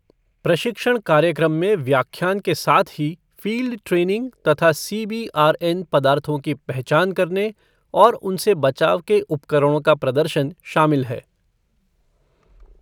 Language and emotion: Hindi, neutral